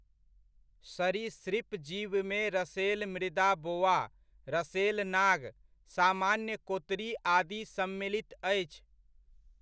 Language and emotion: Maithili, neutral